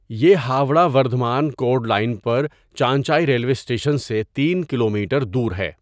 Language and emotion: Urdu, neutral